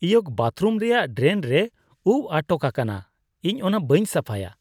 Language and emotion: Santali, disgusted